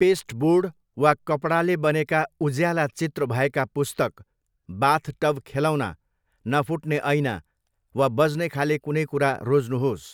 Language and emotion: Nepali, neutral